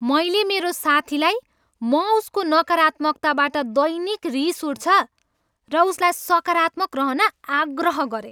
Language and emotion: Nepali, angry